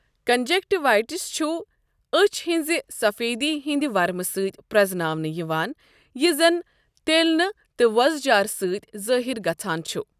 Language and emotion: Kashmiri, neutral